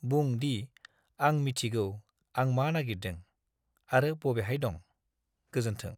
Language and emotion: Bodo, neutral